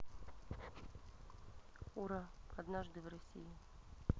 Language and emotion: Russian, neutral